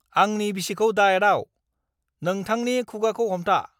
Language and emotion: Bodo, angry